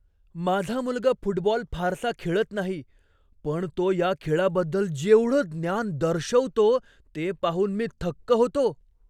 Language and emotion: Marathi, surprised